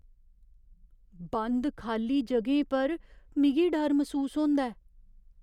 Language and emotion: Dogri, fearful